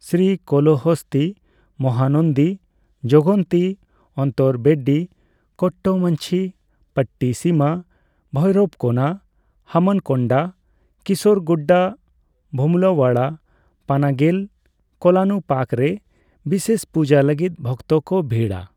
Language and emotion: Santali, neutral